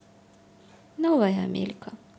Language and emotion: Russian, sad